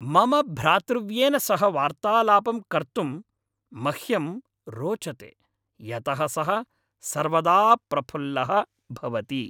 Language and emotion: Sanskrit, happy